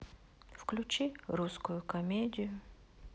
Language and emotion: Russian, sad